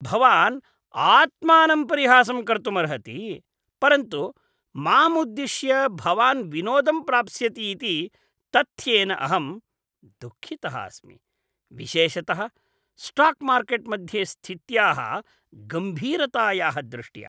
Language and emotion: Sanskrit, disgusted